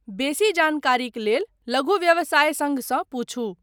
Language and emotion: Maithili, neutral